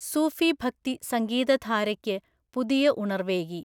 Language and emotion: Malayalam, neutral